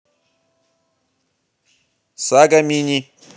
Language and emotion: Russian, neutral